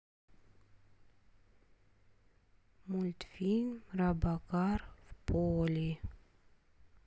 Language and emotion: Russian, neutral